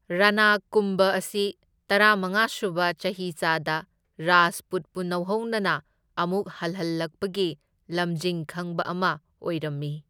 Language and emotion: Manipuri, neutral